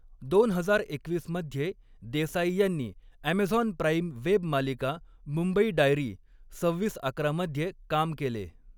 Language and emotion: Marathi, neutral